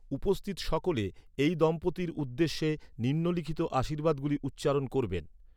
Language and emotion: Bengali, neutral